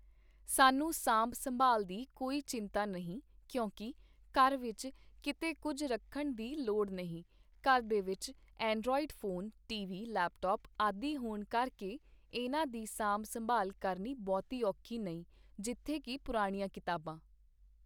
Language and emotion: Punjabi, neutral